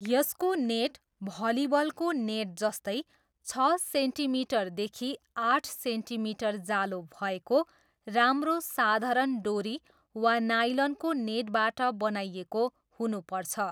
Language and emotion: Nepali, neutral